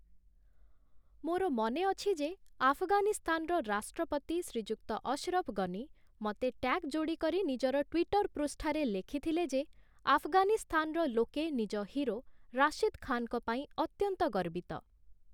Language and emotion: Odia, neutral